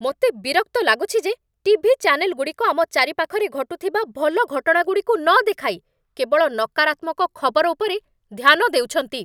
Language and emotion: Odia, angry